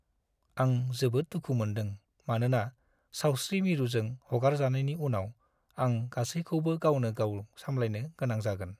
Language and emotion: Bodo, sad